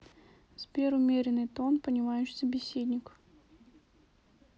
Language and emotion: Russian, neutral